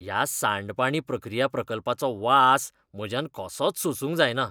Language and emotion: Goan Konkani, disgusted